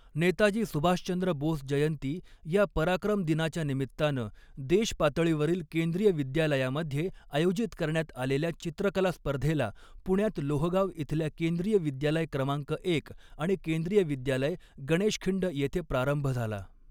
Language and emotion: Marathi, neutral